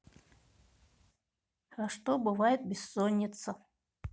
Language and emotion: Russian, neutral